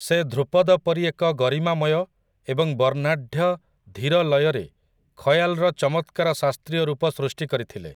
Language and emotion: Odia, neutral